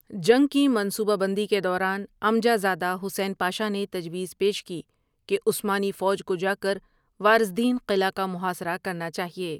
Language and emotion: Urdu, neutral